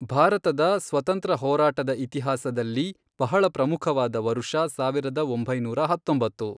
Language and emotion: Kannada, neutral